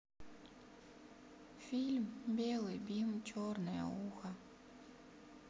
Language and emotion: Russian, sad